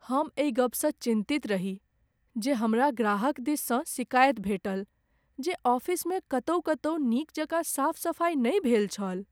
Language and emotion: Maithili, sad